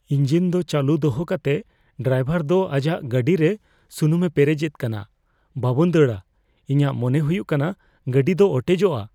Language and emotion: Santali, fearful